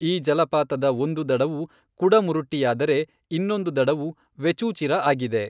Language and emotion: Kannada, neutral